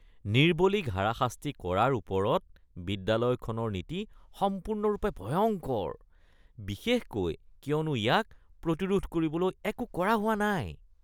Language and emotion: Assamese, disgusted